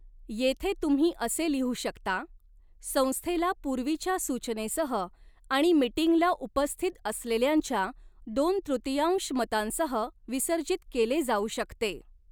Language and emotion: Marathi, neutral